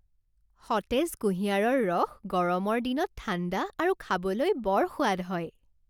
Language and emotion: Assamese, happy